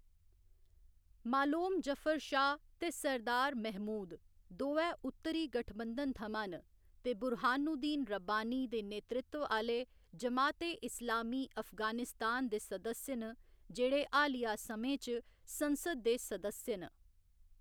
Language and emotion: Dogri, neutral